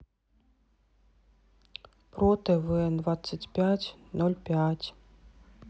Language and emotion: Russian, sad